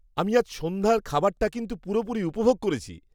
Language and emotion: Bengali, happy